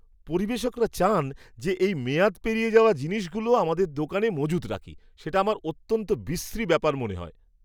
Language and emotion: Bengali, disgusted